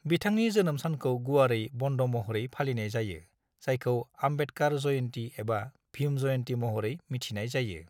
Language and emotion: Bodo, neutral